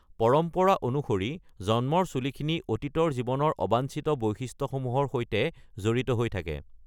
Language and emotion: Assamese, neutral